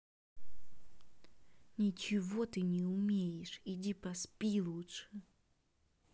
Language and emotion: Russian, angry